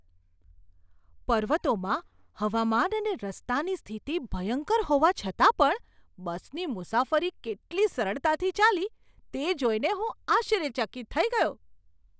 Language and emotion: Gujarati, surprised